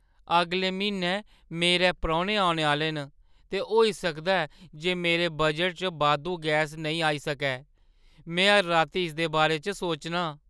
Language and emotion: Dogri, fearful